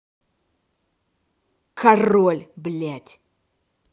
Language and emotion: Russian, angry